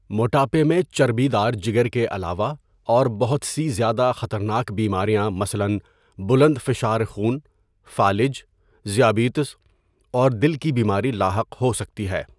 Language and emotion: Urdu, neutral